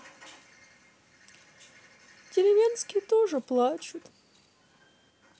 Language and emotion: Russian, sad